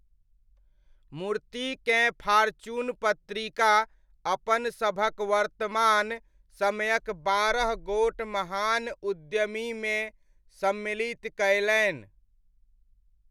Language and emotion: Maithili, neutral